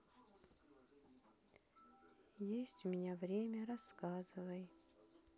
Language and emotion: Russian, sad